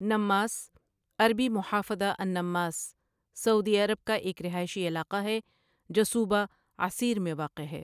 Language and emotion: Urdu, neutral